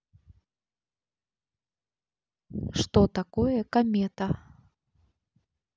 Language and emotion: Russian, neutral